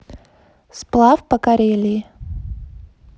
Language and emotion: Russian, neutral